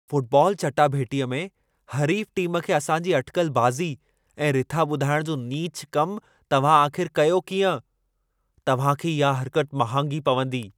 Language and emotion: Sindhi, angry